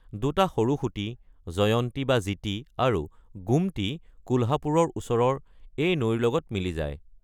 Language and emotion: Assamese, neutral